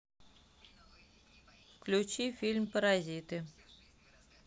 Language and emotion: Russian, neutral